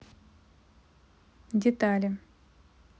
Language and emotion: Russian, neutral